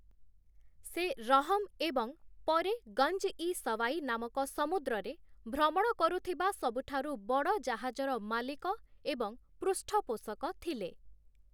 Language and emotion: Odia, neutral